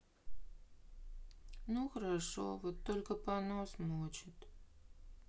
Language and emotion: Russian, sad